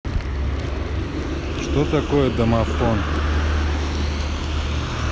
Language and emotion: Russian, neutral